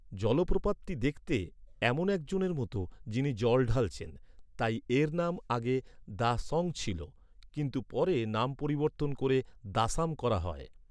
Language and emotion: Bengali, neutral